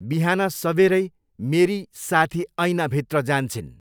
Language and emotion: Nepali, neutral